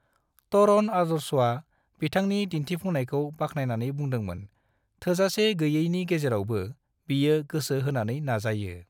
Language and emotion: Bodo, neutral